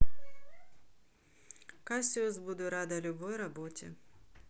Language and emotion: Russian, neutral